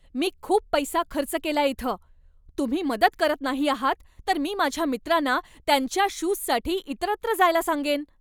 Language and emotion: Marathi, angry